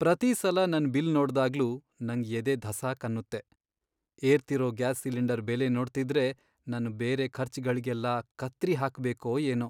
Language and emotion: Kannada, sad